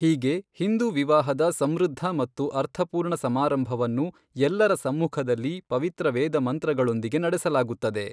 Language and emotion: Kannada, neutral